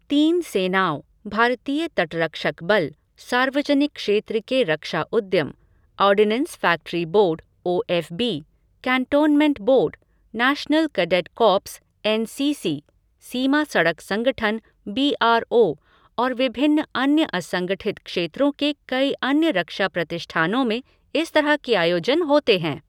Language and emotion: Hindi, neutral